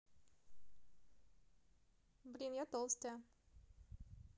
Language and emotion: Russian, positive